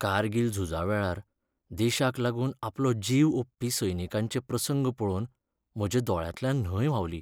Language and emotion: Goan Konkani, sad